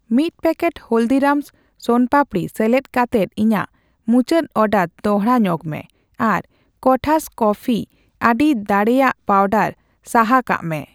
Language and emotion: Santali, neutral